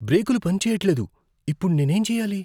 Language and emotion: Telugu, fearful